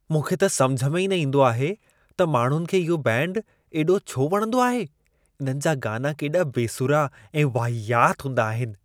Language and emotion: Sindhi, disgusted